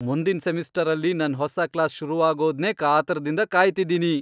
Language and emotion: Kannada, happy